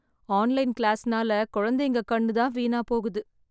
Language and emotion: Tamil, sad